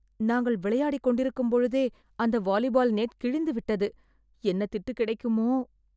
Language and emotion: Tamil, fearful